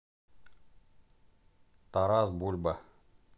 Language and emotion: Russian, neutral